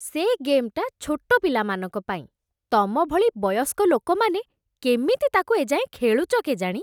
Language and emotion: Odia, disgusted